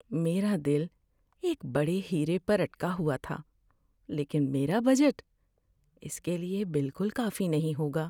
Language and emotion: Urdu, sad